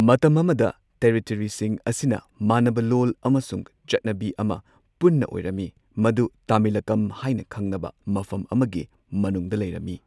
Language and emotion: Manipuri, neutral